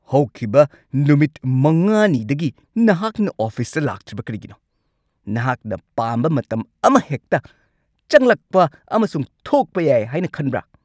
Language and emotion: Manipuri, angry